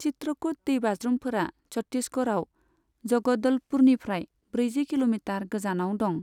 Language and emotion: Bodo, neutral